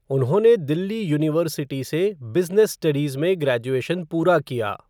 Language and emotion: Hindi, neutral